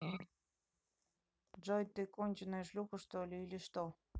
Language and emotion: Russian, neutral